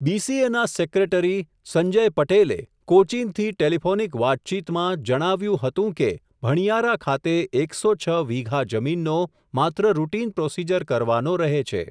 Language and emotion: Gujarati, neutral